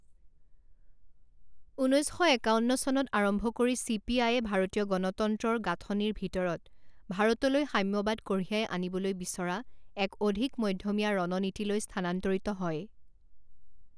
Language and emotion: Assamese, neutral